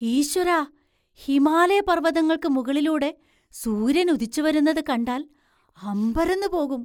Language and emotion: Malayalam, surprised